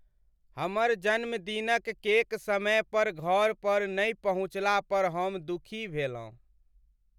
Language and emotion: Maithili, sad